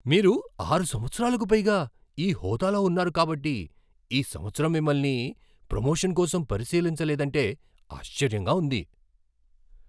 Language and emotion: Telugu, surprised